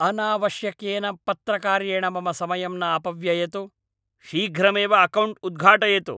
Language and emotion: Sanskrit, angry